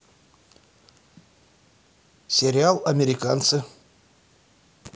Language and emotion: Russian, neutral